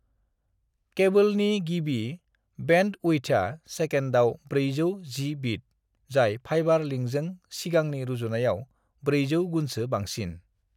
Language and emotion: Bodo, neutral